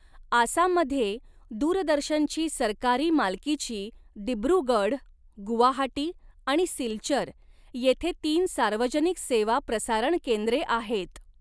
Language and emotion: Marathi, neutral